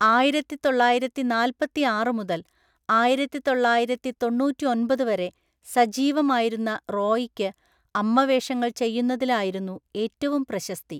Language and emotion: Malayalam, neutral